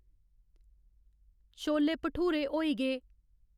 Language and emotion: Dogri, neutral